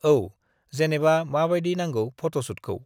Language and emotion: Bodo, neutral